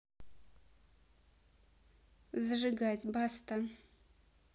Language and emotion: Russian, neutral